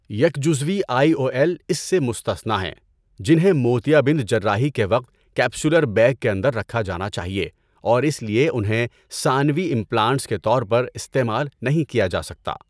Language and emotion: Urdu, neutral